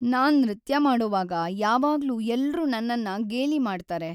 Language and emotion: Kannada, sad